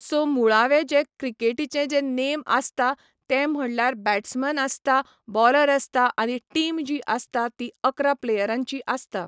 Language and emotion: Goan Konkani, neutral